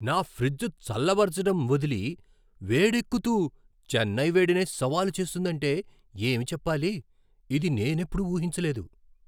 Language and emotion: Telugu, surprised